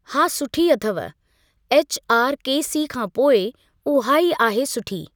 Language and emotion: Sindhi, neutral